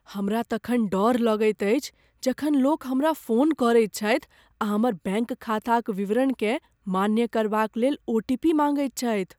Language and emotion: Maithili, fearful